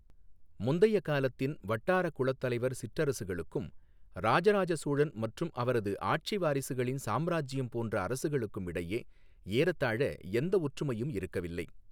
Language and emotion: Tamil, neutral